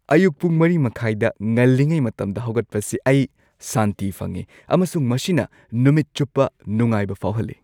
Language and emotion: Manipuri, happy